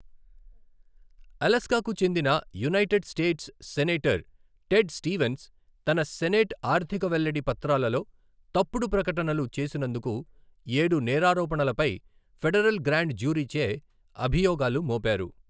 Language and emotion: Telugu, neutral